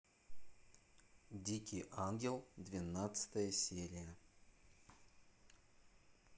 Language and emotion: Russian, neutral